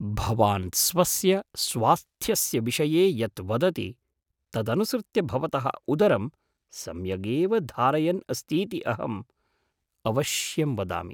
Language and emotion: Sanskrit, surprised